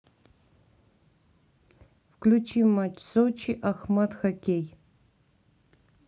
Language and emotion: Russian, neutral